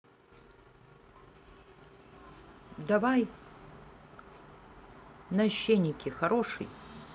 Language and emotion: Russian, neutral